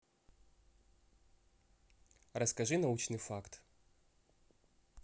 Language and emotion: Russian, neutral